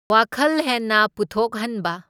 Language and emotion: Manipuri, neutral